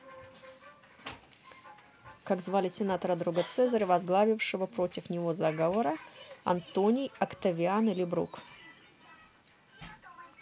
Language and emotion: Russian, neutral